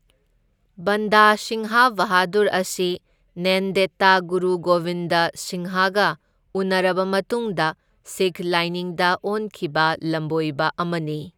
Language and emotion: Manipuri, neutral